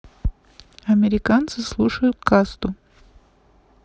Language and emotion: Russian, neutral